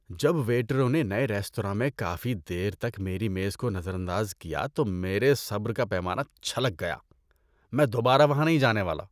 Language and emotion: Urdu, disgusted